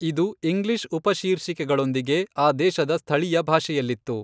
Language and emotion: Kannada, neutral